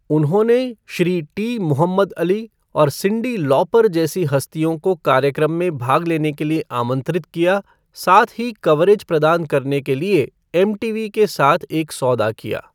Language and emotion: Hindi, neutral